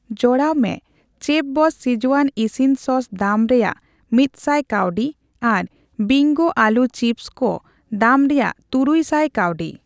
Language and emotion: Santali, neutral